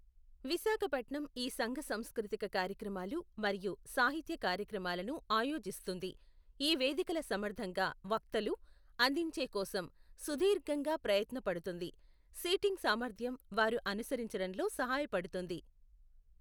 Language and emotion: Telugu, neutral